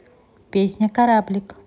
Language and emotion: Russian, neutral